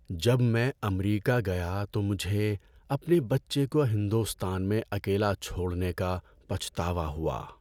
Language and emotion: Urdu, sad